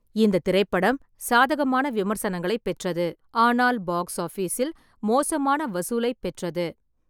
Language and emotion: Tamil, neutral